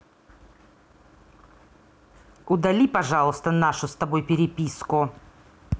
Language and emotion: Russian, angry